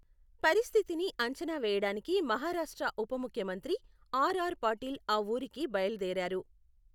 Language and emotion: Telugu, neutral